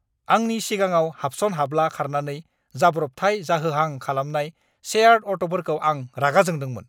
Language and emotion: Bodo, angry